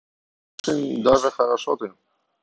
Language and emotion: Russian, neutral